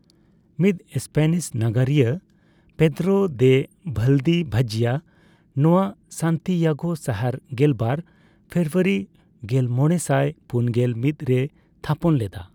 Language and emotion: Santali, neutral